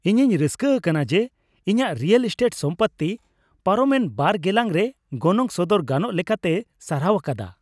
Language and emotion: Santali, happy